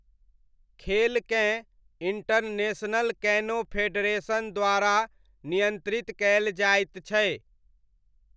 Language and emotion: Maithili, neutral